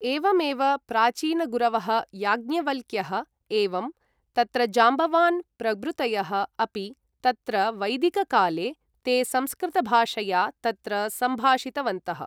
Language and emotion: Sanskrit, neutral